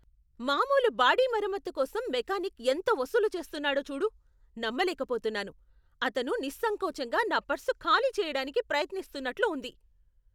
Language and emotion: Telugu, angry